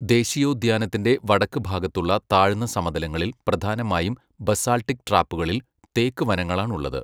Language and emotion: Malayalam, neutral